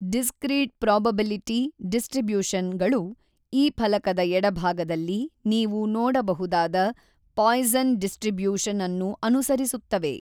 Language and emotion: Kannada, neutral